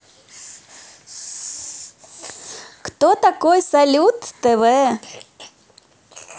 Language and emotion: Russian, positive